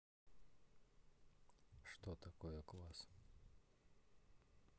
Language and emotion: Russian, neutral